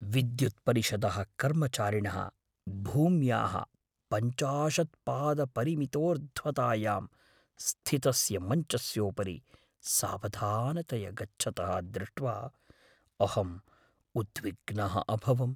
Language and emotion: Sanskrit, fearful